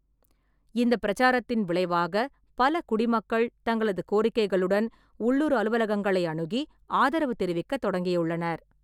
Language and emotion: Tamil, neutral